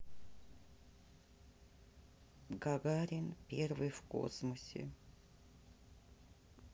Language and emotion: Russian, sad